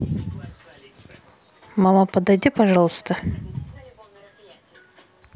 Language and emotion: Russian, neutral